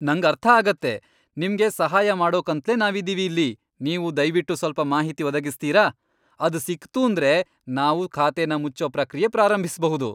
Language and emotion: Kannada, happy